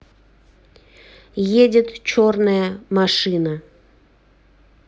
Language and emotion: Russian, neutral